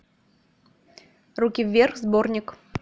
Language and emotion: Russian, neutral